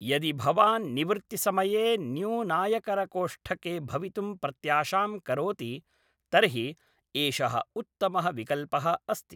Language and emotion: Sanskrit, neutral